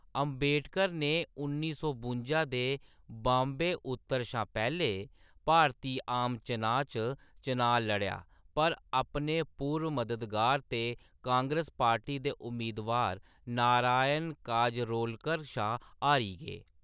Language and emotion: Dogri, neutral